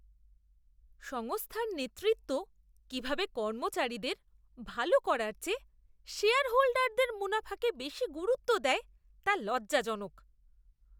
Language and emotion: Bengali, disgusted